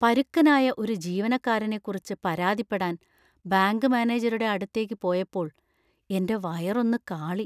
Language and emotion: Malayalam, fearful